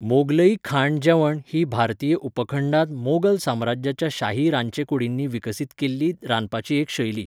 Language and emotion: Goan Konkani, neutral